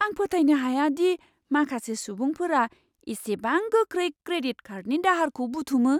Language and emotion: Bodo, surprised